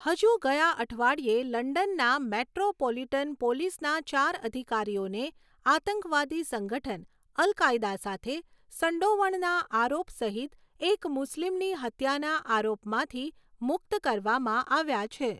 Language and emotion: Gujarati, neutral